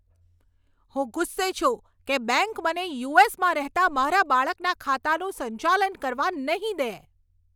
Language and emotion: Gujarati, angry